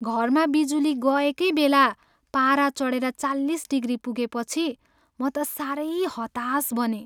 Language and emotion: Nepali, sad